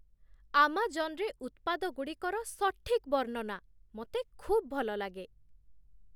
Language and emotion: Odia, surprised